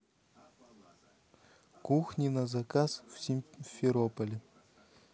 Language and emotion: Russian, neutral